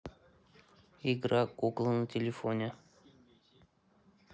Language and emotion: Russian, neutral